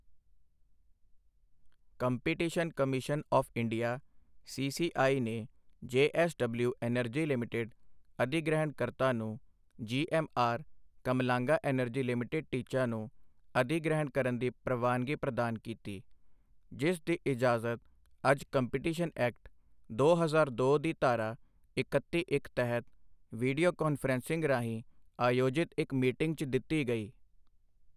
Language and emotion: Punjabi, neutral